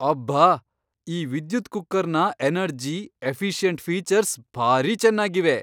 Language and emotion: Kannada, surprised